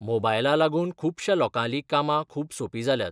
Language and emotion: Goan Konkani, neutral